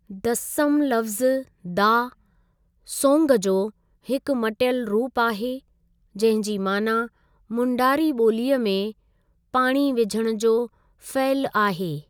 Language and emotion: Sindhi, neutral